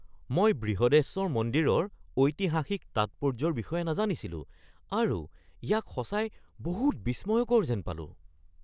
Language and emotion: Assamese, surprised